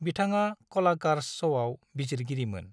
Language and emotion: Bodo, neutral